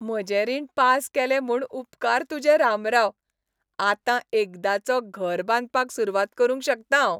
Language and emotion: Goan Konkani, happy